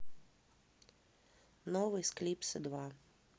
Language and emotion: Russian, neutral